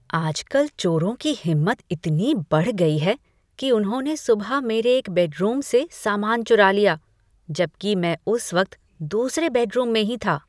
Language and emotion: Hindi, disgusted